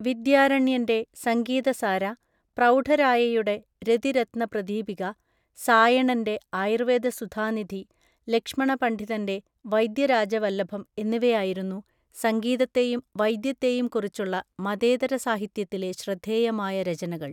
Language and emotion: Malayalam, neutral